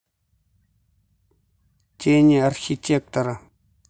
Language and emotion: Russian, neutral